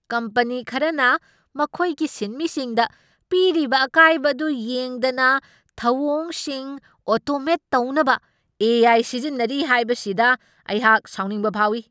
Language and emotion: Manipuri, angry